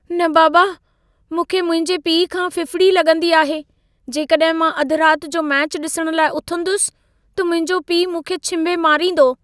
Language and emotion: Sindhi, fearful